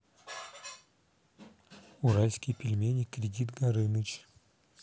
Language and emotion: Russian, neutral